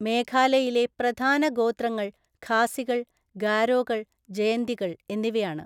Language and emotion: Malayalam, neutral